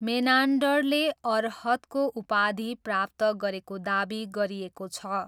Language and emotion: Nepali, neutral